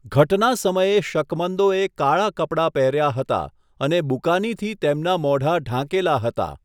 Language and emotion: Gujarati, neutral